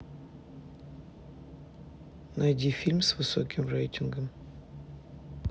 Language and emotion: Russian, neutral